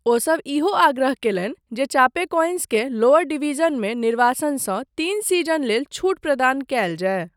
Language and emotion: Maithili, neutral